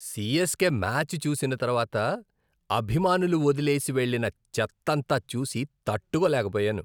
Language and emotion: Telugu, disgusted